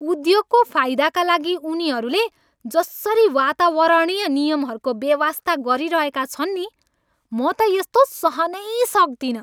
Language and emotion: Nepali, angry